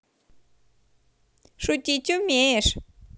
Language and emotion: Russian, positive